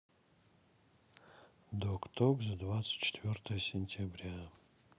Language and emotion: Russian, sad